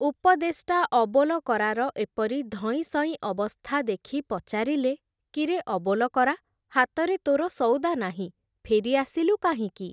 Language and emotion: Odia, neutral